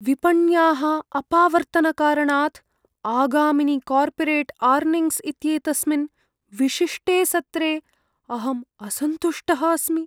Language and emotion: Sanskrit, fearful